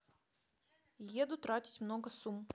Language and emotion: Russian, neutral